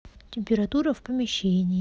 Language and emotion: Russian, neutral